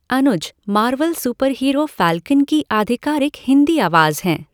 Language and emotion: Hindi, neutral